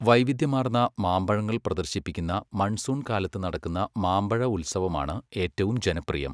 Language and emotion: Malayalam, neutral